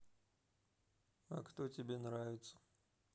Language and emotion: Russian, neutral